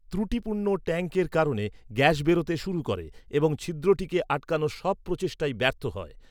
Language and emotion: Bengali, neutral